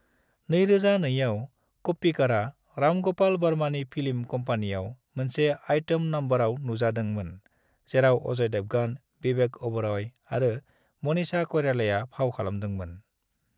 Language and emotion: Bodo, neutral